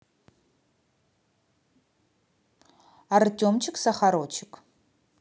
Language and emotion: Russian, positive